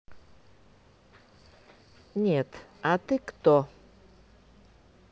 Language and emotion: Russian, neutral